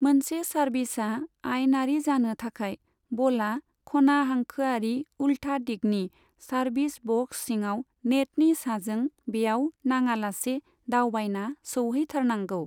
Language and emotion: Bodo, neutral